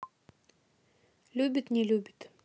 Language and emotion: Russian, neutral